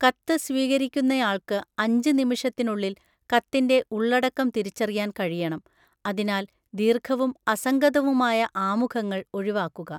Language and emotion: Malayalam, neutral